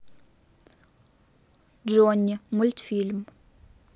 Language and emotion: Russian, neutral